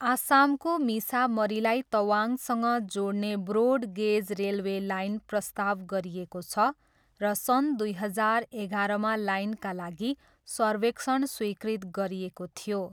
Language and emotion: Nepali, neutral